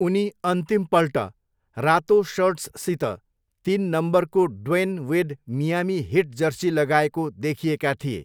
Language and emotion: Nepali, neutral